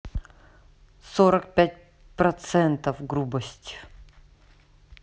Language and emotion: Russian, neutral